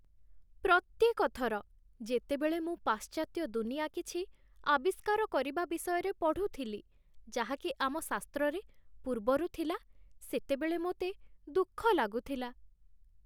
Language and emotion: Odia, sad